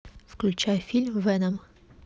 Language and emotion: Russian, neutral